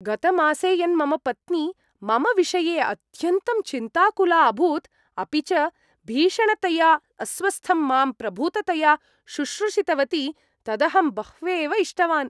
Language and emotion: Sanskrit, happy